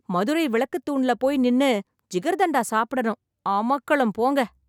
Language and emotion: Tamil, happy